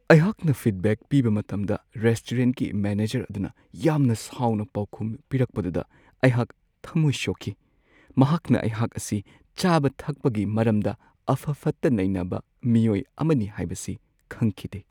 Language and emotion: Manipuri, sad